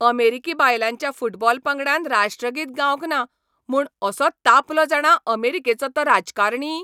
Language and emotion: Goan Konkani, angry